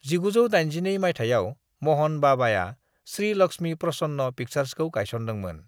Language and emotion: Bodo, neutral